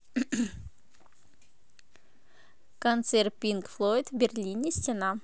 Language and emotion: Russian, positive